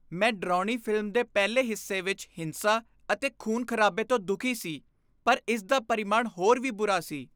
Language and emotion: Punjabi, disgusted